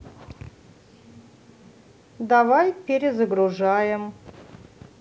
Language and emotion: Russian, neutral